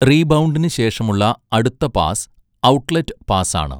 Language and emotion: Malayalam, neutral